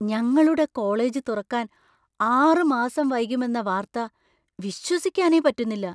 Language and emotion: Malayalam, surprised